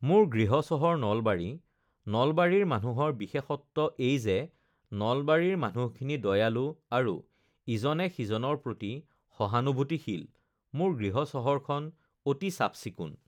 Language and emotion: Assamese, neutral